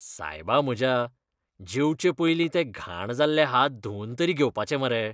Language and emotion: Goan Konkani, disgusted